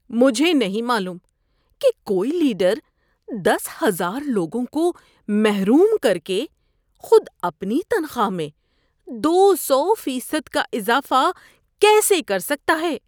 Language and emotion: Urdu, disgusted